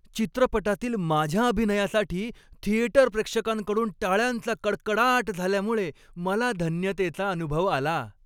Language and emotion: Marathi, happy